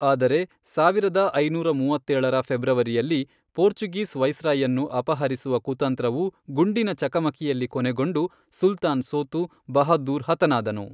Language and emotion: Kannada, neutral